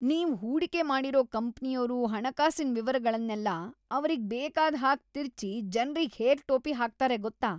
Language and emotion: Kannada, disgusted